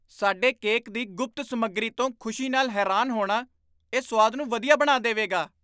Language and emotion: Punjabi, surprised